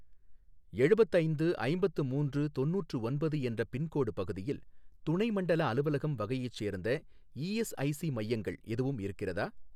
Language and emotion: Tamil, neutral